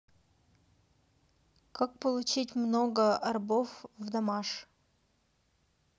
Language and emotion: Russian, neutral